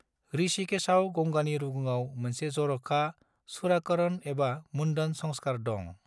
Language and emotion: Bodo, neutral